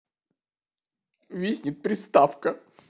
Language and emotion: Russian, sad